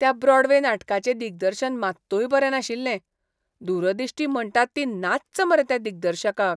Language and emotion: Goan Konkani, disgusted